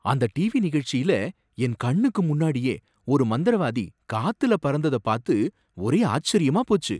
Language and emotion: Tamil, surprised